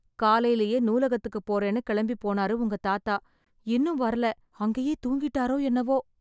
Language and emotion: Tamil, sad